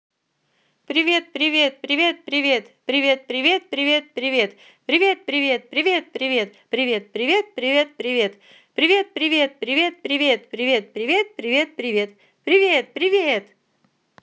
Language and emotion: Russian, positive